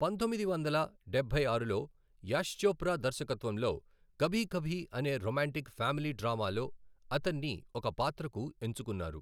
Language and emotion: Telugu, neutral